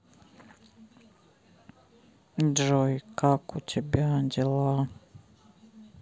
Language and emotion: Russian, sad